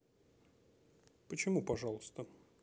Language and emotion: Russian, neutral